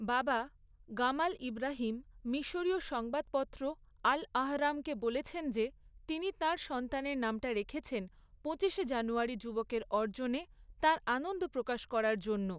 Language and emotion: Bengali, neutral